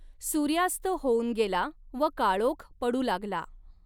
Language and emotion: Marathi, neutral